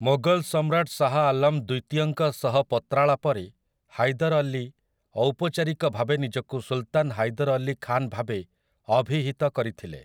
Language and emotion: Odia, neutral